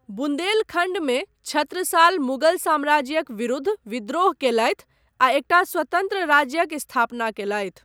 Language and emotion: Maithili, neutral